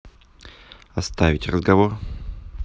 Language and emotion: Russian, neutral